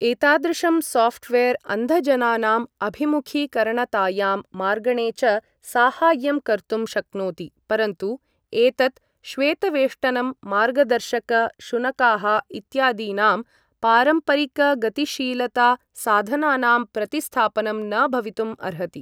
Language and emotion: Sanskrit, neutral